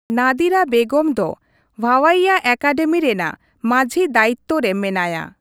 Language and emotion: Santali, neutral